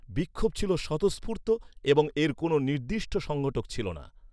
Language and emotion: Bengali, neutral